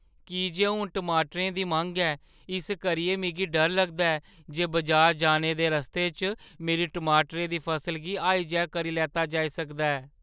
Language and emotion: Dogri, fearful